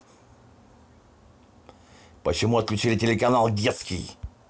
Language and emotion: Russian, angry